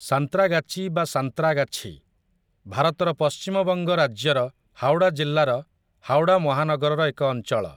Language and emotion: Odia, neutral